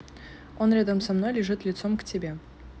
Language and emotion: Russian, neutral